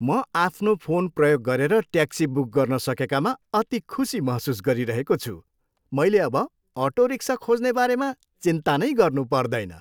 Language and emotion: Nepali, happy